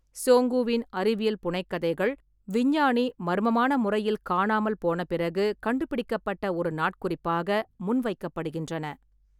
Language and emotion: Tamil, neutral